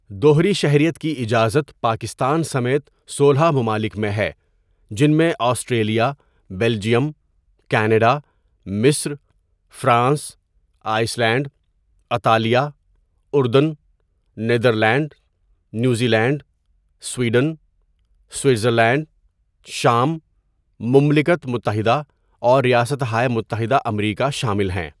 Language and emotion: Urdu, neutral